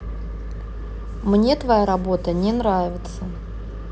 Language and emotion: Russian, neutral